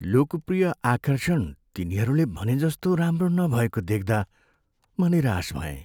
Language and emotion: Nepali, sad